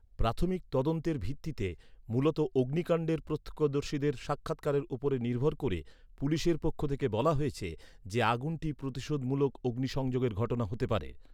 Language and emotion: Bengali, neutral